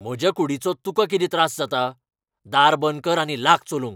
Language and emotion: Goan Konkani, angry